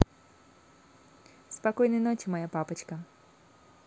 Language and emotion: Russian, positive